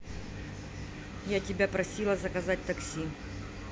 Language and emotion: Russian, angry